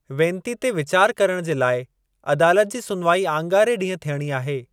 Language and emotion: Sindhi, neutral